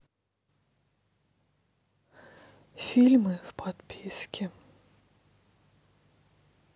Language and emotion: Russian, sad